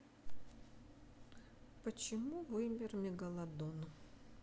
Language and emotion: Russian, sad